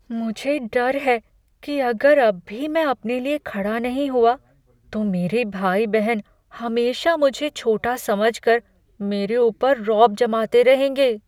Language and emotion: Hindi, fearful